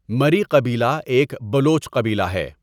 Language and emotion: Urdu, neutral